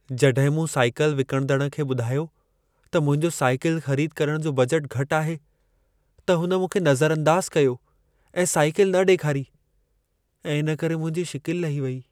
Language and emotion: Sindhi, sad